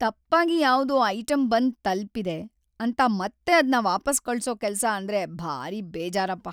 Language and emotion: Kannada, sad